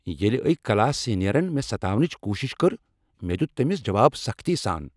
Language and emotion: Kashmiri, angry